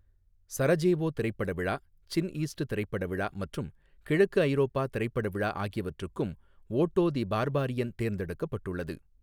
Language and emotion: Tamil, neutral